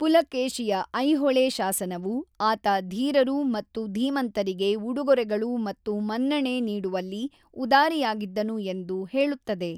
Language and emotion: Kannada, neutral